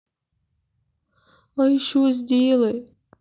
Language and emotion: Russian, sad